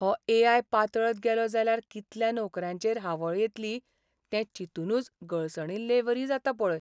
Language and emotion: Goan Konkani, sad